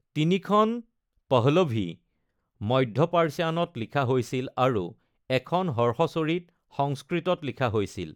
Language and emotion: Assamese, neutral